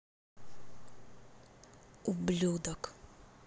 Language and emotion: Russian, angry